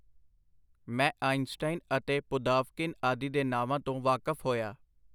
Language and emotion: Punjabi, neutral